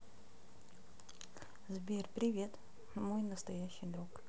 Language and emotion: Russian, neutral